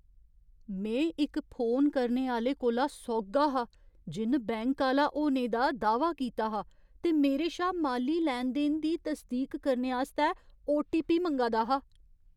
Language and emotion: Dogri, fearful